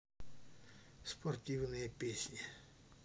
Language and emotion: Russian, neutral